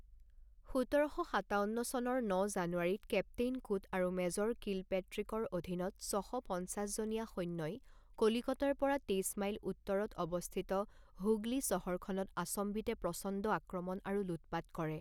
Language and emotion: Assamese, neutral